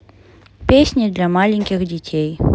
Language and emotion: Russian, neutral